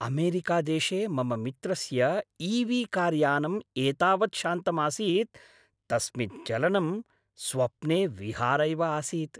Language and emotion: Sanskrit, happy